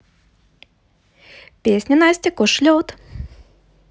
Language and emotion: Russian, positive